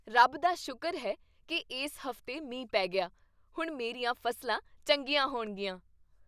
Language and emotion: Punjabi, happy